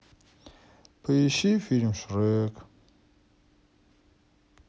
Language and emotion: Russian, sad